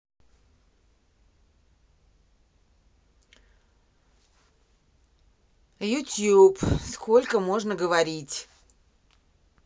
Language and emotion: Russian, angry